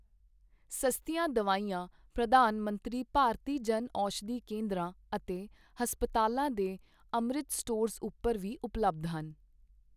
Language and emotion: Punjabi, neutral